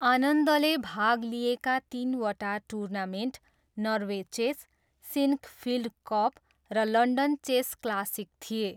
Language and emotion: Nepali, neutral